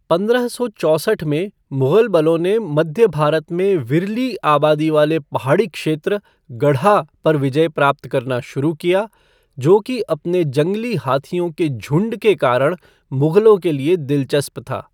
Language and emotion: Hindi, neutral